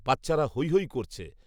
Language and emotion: Bengali, neutral